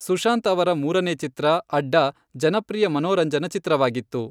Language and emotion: Kannada, neutral